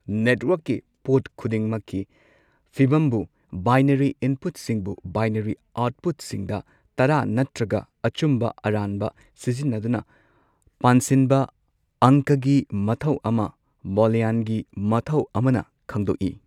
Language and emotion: Manipuri, neutral